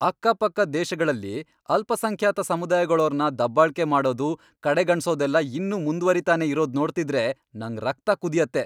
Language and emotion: Kannada, angry